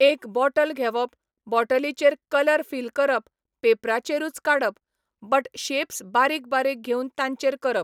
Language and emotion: Goan Konkani, neutral